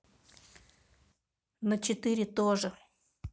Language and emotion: Russian, neutral